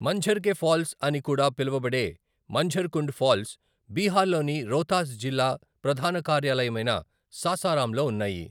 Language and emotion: Telugu, neutral